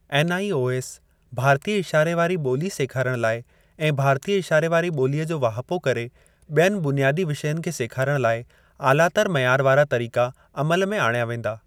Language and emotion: Sindhi, neutral